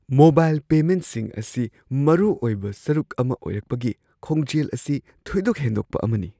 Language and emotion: Manipuri, surprised